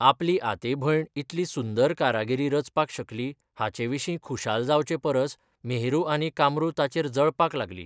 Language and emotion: Goan Konkani, neutral